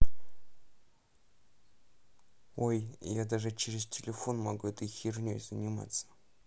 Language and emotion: Russian, neutral